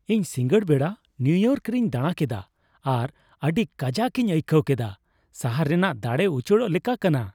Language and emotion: Santali, happy